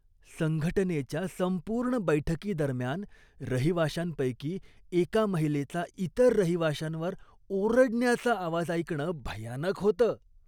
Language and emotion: Marathi, disgusted